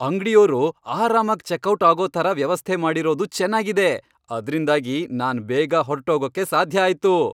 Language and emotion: Kannada, happy